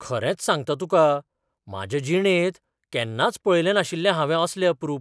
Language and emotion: Goan Konkani, surprised